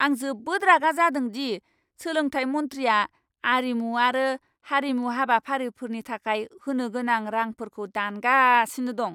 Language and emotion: Bodo, angry